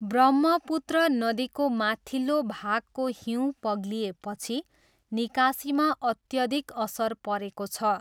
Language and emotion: Nepali, neutral